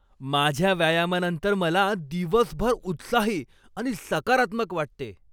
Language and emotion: Marathi, happy